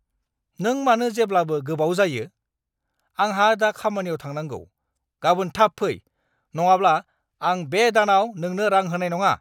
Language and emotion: Bodo, angry